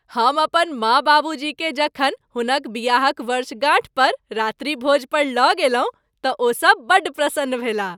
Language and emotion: Maithili, happy